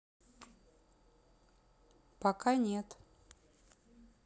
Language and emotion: Russian, neutral